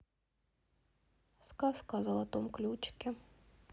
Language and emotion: Russian, sad